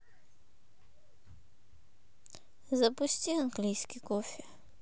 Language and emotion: Russian, sad